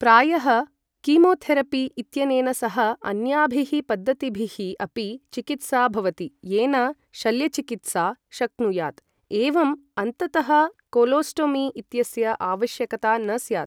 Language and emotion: Sanskrit, neutral